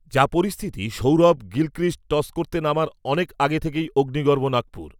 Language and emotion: Bengali, neutral